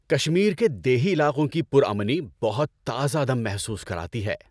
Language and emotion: Urdu, happy